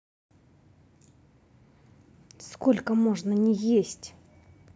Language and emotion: Russian, angry